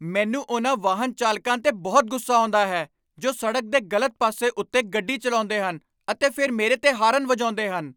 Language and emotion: Punjabi, angry